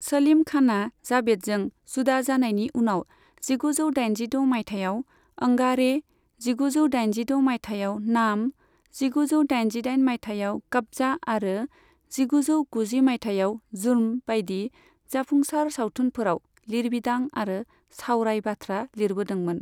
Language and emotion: Bodo, neutral